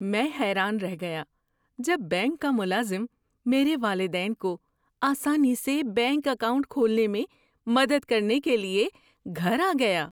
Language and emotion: Urdu, surprised